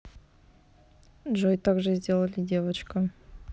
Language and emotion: Russian, neutral